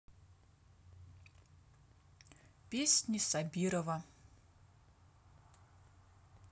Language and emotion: Russian, neutral